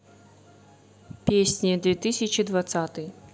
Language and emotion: Russian, neutral